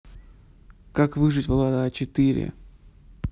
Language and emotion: Russian, neutral